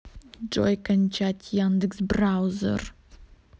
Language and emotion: Russian, angry